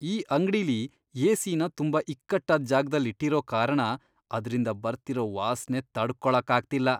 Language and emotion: Kannada, disgusted